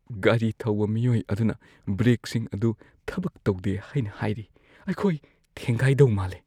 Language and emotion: Manipuri, fearful